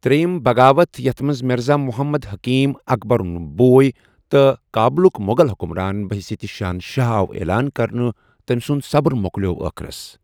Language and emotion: Kashmiri, neutral